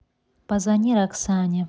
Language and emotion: Russian, neutral